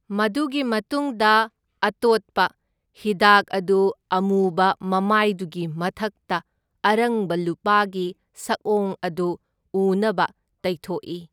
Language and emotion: Manipuri, neutral